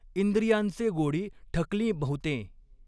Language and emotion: Marathi, neutral